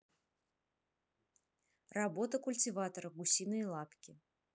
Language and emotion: Russian, neutral